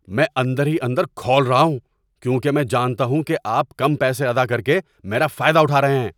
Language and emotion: Urdu, angry